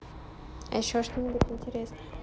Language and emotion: Russian, neutral